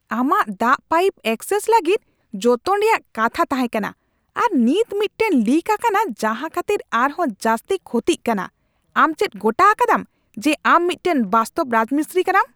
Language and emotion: Santali, angry